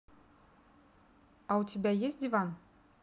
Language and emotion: Russian, neutral